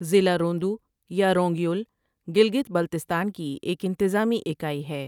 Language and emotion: Urdu, neutral